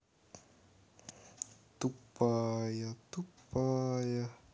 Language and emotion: Russian, neutral